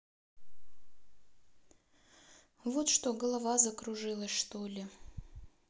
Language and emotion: Russian, sad